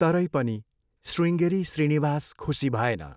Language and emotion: Nepali, neutral